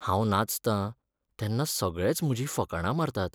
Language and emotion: Goan Konkani, sad